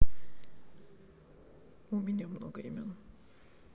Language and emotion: Russian, neutral